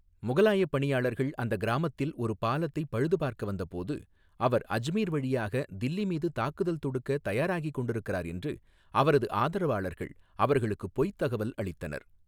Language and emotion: Tamil, neutral